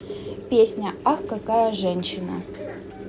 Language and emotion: Russian, neutral